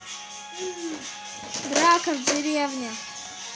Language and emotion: Russian, neutral